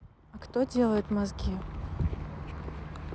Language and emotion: Russian, neutral